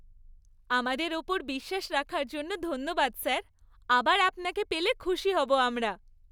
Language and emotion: Bengali, happy